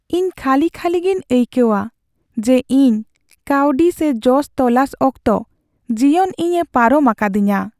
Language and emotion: Santali, sad